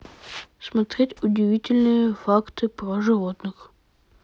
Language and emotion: Russian, neutral